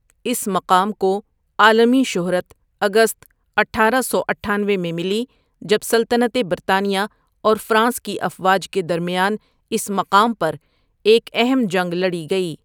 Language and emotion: Urdu, neutral